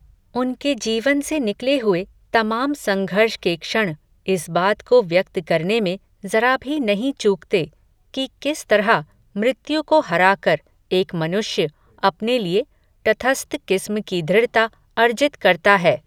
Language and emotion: Hindi, neutral